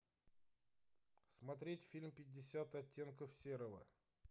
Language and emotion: Russian, neutral